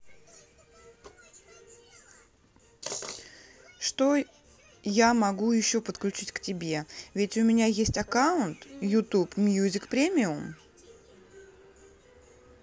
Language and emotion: Russian, neutral